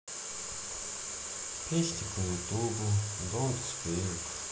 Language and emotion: Russian, sad